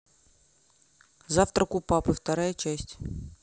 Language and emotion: Russian, neutral